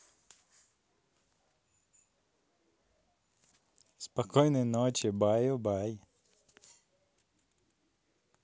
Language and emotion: Russian, positive